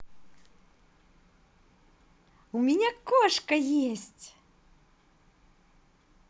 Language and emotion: Russian, positive